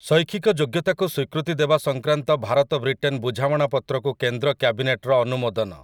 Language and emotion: Odia, neutral